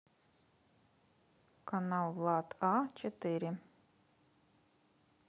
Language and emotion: Russian, neutral